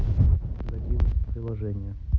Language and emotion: Russian, neutral